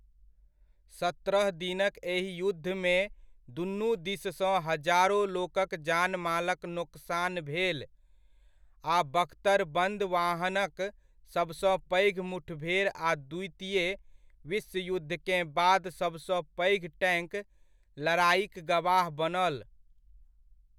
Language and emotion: Maithili, neutral